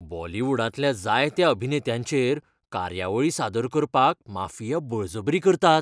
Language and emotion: Goan Konkani, fearful